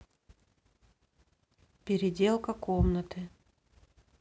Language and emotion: Russian, neutral